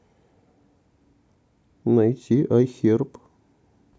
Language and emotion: Russian, neutral